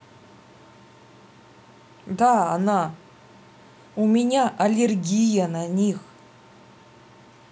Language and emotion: Russian, angry